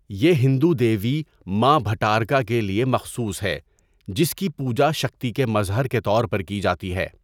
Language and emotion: Urdu, neutral